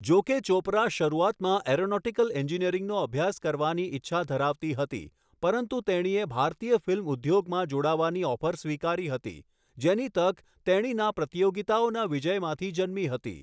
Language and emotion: Gujarati, neutral